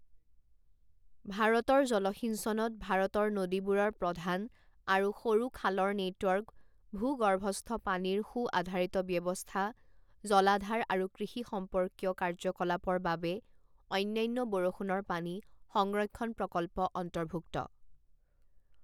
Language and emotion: Assamese, neutral